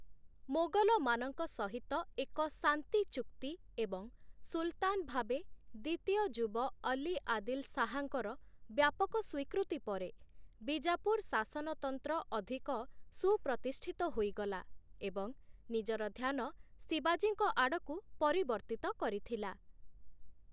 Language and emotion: Odia, neutral